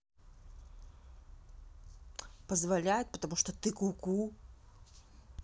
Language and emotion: Russian, angry